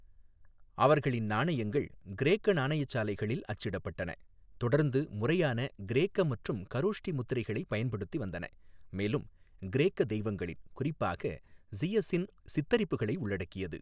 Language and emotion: Tamil, neutral